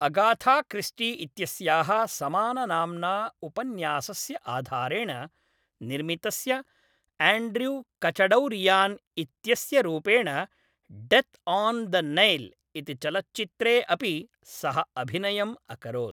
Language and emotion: Sanskrit, neutral